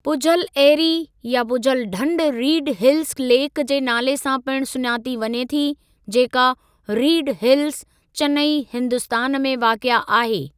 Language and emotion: Sindhi, neutral